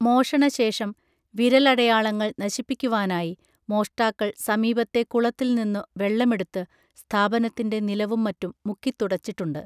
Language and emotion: Malayalam, neutral